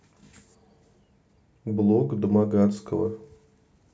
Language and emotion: Russian, neutral